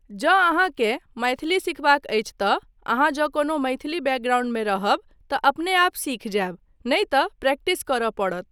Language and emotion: Maithili, neutral